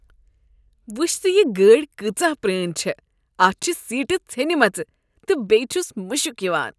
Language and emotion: Kashmiri, disgusted